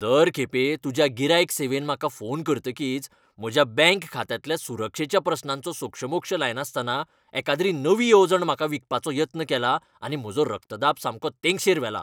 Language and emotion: Goan Konkani, angry